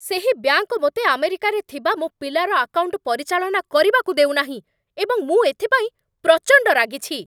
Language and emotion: Odia, angry